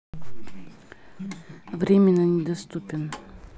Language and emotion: Russian, neutral